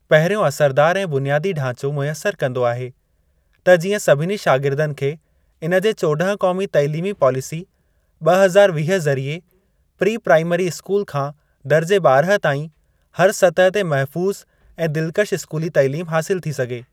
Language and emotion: Sindhi, neutral